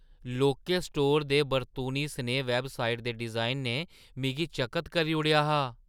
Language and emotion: Dogri, surprised